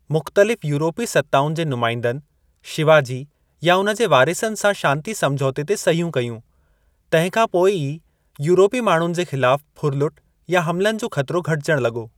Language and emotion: Sindhi, neutral